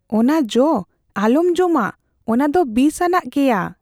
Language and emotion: Santali, fearful